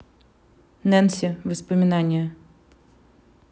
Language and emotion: Russian, neutral